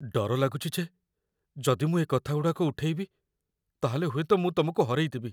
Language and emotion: Odia, fearful